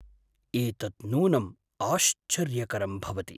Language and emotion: Sanskrit, surprised